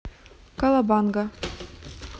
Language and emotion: Russian, neutral